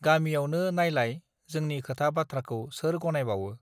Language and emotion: Bodo, neutral